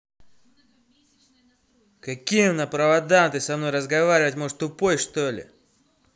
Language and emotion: Russian, angry